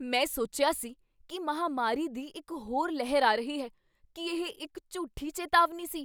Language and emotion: Punjabi, surprised